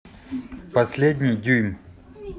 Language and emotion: Russian, neutral